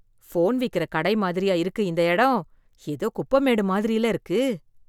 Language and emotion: Tamil, disgusted